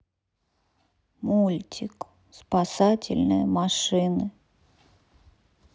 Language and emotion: Russian, sad